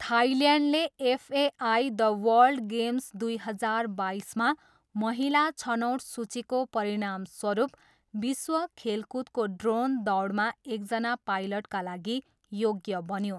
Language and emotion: Nepali, neutral